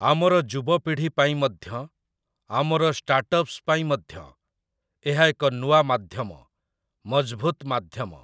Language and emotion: Odia, neutral